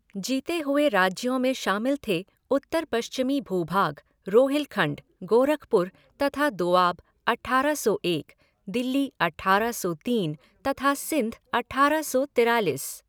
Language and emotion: Hindi, neutral